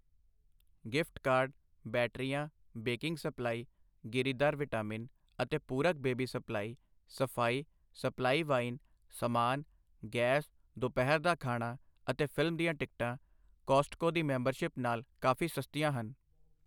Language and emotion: Punjabi, neutral